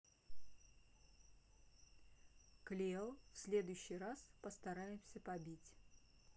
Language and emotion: Russian, neutral